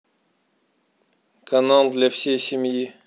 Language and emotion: Russian, neutral